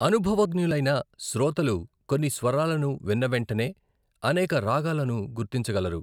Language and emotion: Telugu, neutral